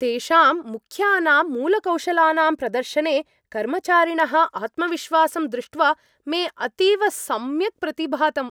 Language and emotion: Sanskrit, happy